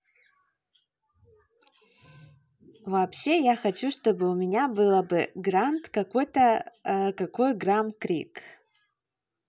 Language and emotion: Russian, positive